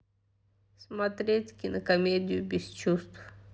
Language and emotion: Russian, sad